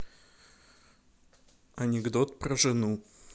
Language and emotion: Russian, neutral